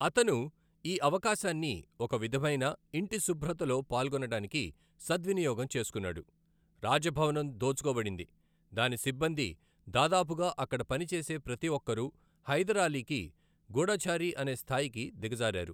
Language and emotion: Telugu, neutral